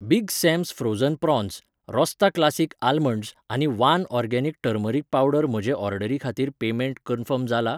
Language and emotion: Goan Konkani, neutral